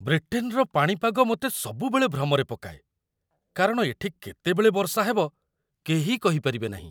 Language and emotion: Odia, surprised